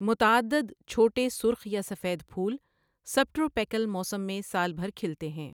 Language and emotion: Urdu, neutral